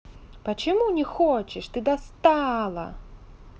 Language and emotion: Russian, angry